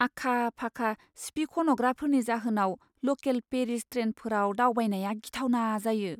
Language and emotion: Bodo, fearful